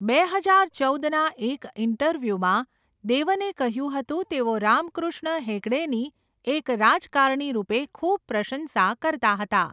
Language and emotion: Gujarati, neutral